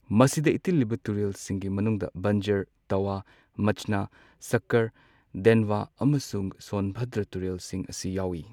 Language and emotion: Manipuri, neutral